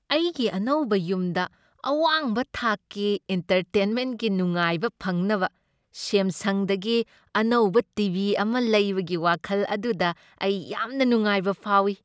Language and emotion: Manipuri, happy